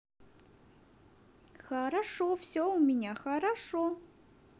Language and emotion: Russian, positive